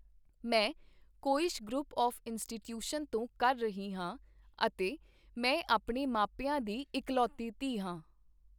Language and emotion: Punjabi, neutral